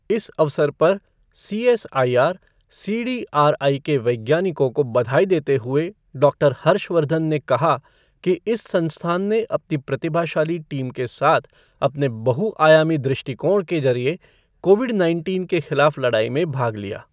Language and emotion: Hindi, neutral